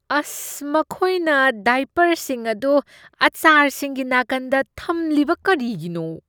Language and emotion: Manipuri, disgusted